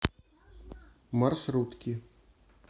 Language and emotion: Russian, neutral